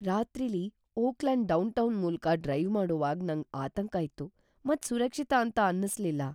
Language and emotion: Kannada, fearful